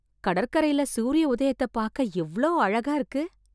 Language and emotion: Tamil, happy